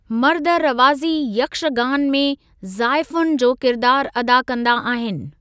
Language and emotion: Sindhi, neutral